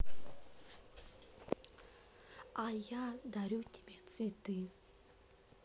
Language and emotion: Russian, neutral